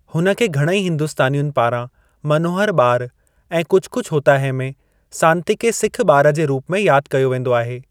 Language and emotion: Sindhi, neutral